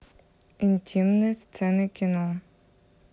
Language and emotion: Russian, neutral